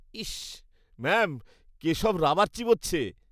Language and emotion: Bengali, disgusted